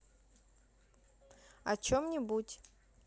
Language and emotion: Russian, neutral